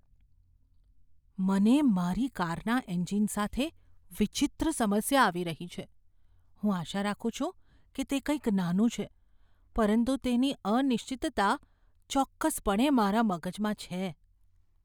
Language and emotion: Gujarati, fearful